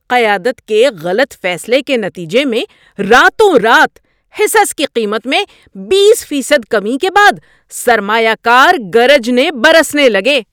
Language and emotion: Urdu, angry